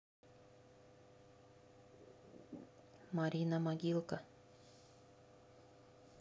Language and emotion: Russian, neutral